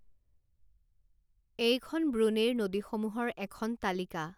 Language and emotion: Assamese, neutral